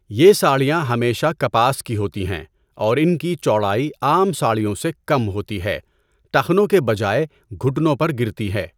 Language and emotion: Urdu, neutral